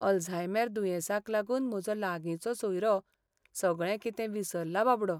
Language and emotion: Goan Konkani, sad